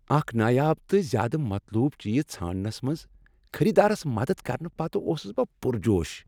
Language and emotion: Kashmiri, happy